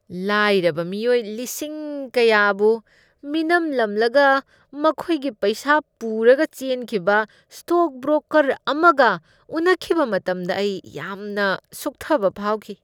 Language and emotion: Manipuri, disgusted